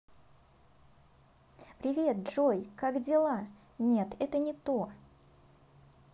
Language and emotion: Russian, positive